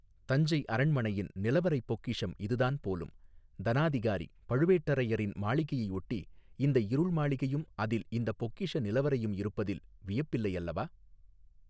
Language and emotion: Tamil, neutral